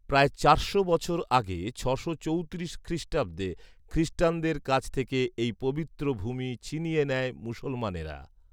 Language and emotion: Bengali, neutral